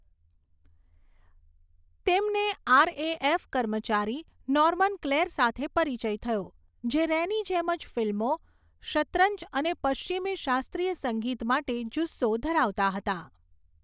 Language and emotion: Gujarati, neutral